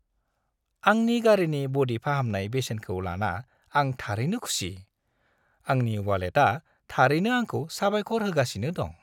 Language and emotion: Bodo, happy